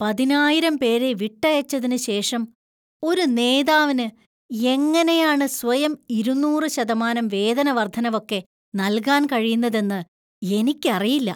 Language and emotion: Malayalam, disgusted